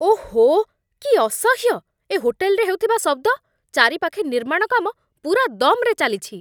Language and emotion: Odia, angry